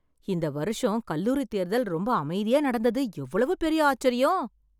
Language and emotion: Tamil, surprised